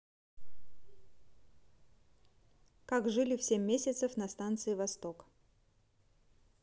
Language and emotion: Russian, neutral